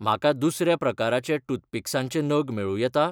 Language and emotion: Goan Konkani, neutral